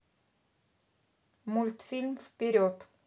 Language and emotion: Russian, neutral